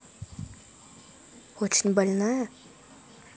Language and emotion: Russian, neutral